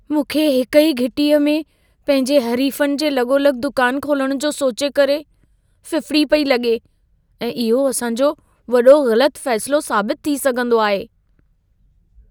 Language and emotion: Sindhi, fearful